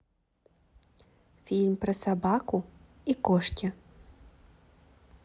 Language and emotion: Russian, positive